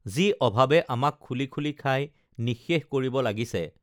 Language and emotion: Assamese, neutral